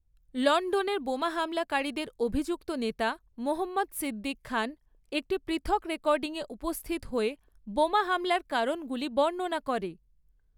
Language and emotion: Bengali, neutral